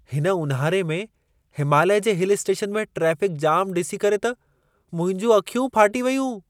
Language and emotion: Sindhi, surprised